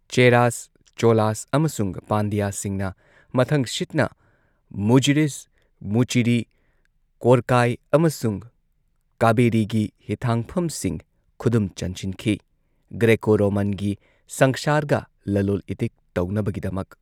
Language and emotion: Manipuri, neutral